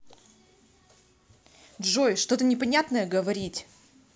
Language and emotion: Russian, angry